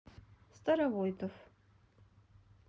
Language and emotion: Russian, neutral